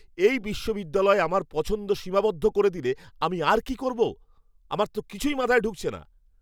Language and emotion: Bengali, angry